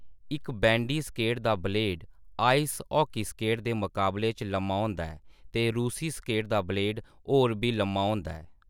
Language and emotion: Dogri, neutral